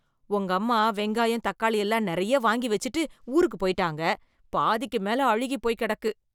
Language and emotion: Tamil, disgusted